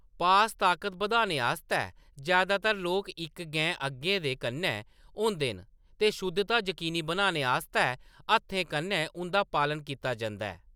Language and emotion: Dogri, neutral